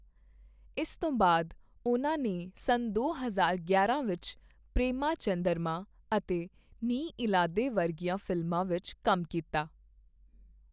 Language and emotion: Punjabi, neutral